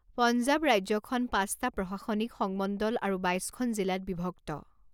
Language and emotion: Assamese, neutral